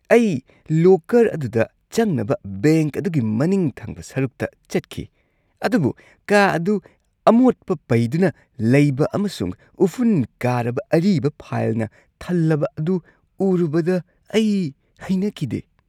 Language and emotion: Manipuri, disgusted